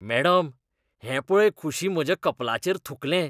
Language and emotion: Goan Konkani, disgusted